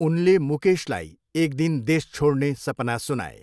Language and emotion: Nepali, neutral